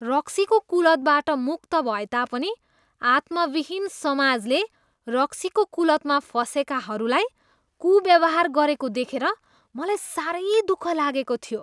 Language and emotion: Nepali, disgusted